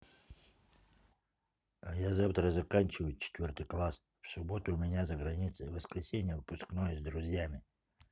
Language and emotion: Russian, neutral